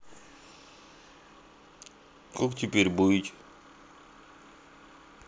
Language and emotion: Russian, sad